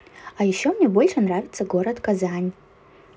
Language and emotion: Russian, positive